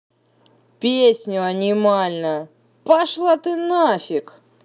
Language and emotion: Russian, angry